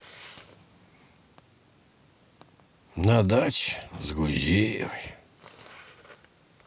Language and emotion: Russian, sad